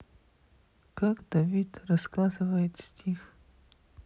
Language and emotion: Russian, sad